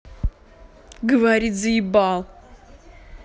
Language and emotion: Russian, angry